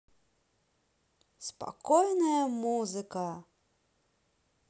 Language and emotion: Russian, neutral